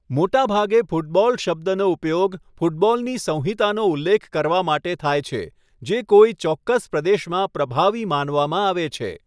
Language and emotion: Gujarati, neutral